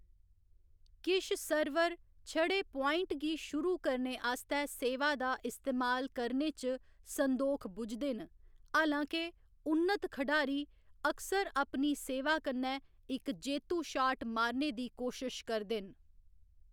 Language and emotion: Dogri, neutral